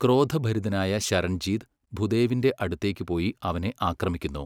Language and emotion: Malayalam, neutral